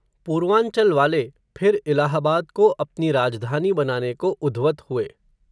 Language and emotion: Hindi, neutral